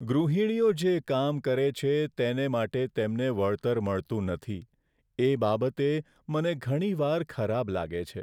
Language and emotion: Gujarati, sad